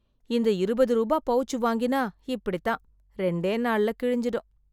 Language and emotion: Tamil, disgusted